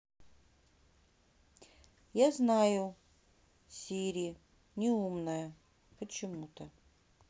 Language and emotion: Russian, neutral